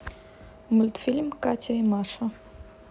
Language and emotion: Russian, neutral